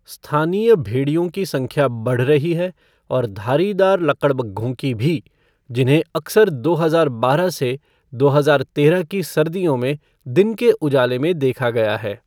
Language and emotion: Hindi, neutral